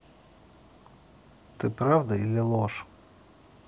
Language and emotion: Russian, neutral